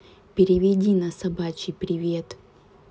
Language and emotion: Russian, neutral